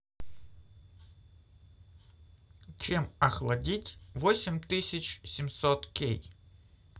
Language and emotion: Russian, neutral